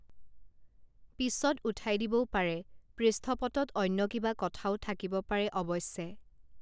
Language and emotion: Assamese, neutral